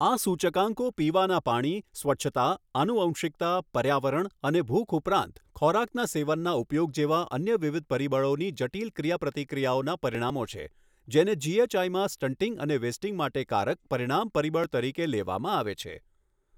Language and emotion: Gujarati, neutral